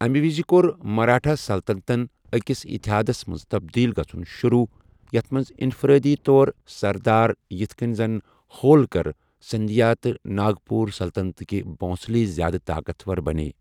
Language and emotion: Kashmiri, neutral